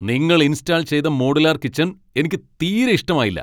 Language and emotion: Malayalam, angry